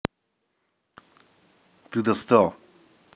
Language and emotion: Russian, angry